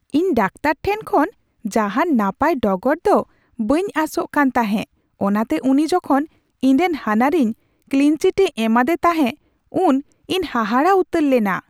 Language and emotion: Santali, surprised